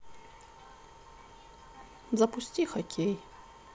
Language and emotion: Russian, sad